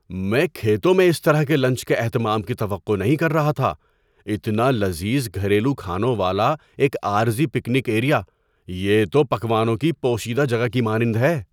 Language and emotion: Urdu, surprised